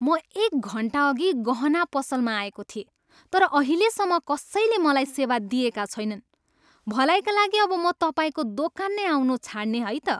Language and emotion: Nepali, angry